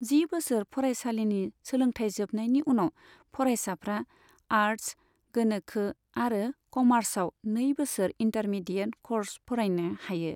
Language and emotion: Bodo, neutral